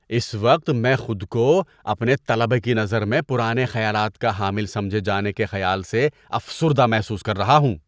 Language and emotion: Urdu, disgusted